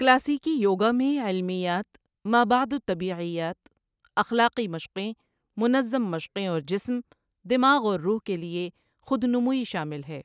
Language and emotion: Urdu, neutral